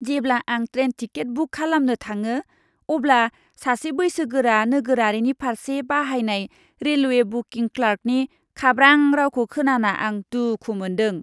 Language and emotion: Bodo, disgusted